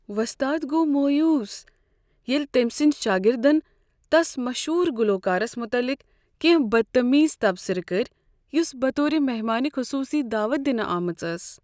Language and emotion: Kashmiri, sad